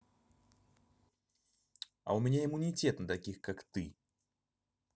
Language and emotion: Russian, angry